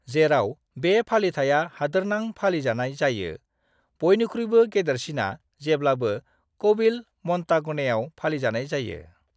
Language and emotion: Bodo, neutral